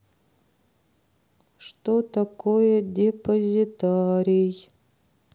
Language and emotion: Russian, sad